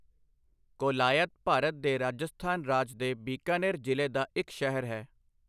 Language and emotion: Punjabi, neutral